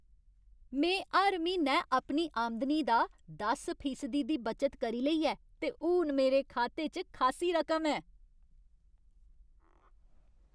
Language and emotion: Dogri, happy